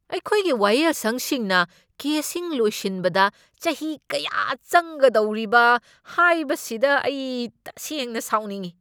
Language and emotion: Manipuri, angry